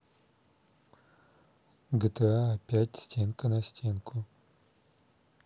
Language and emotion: Russian, neutral